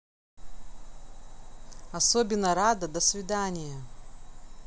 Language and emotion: Russian, neutral